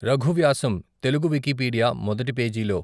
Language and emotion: Telugu, neutral